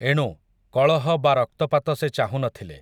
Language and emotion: Odia, neutral